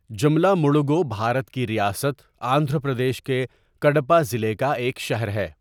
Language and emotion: Urdu, neutral